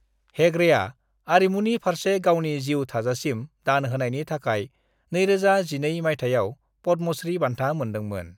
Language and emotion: Bodo, neutral